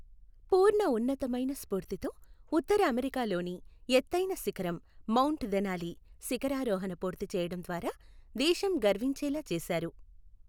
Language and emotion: Telugu, neutral